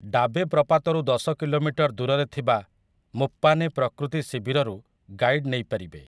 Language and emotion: Odia, neutral